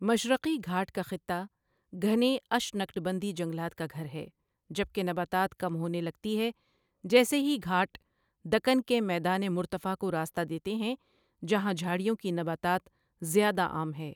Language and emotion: Urdu, neutral